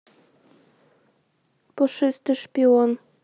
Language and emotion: Russian, neutral